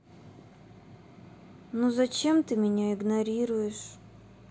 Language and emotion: Russian, sad